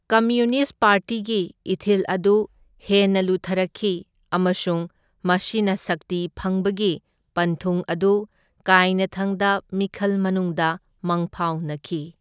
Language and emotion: Manipuri, neutral